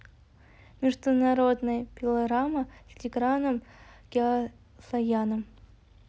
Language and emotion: Russian, neutral